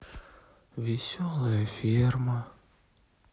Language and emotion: Russian, sad